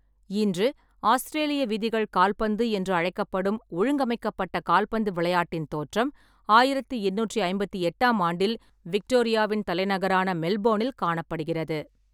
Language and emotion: Tamil, neutral